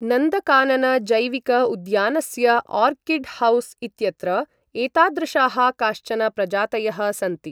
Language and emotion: Sanskrit, neutral